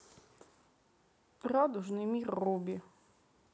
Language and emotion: Russian, neutral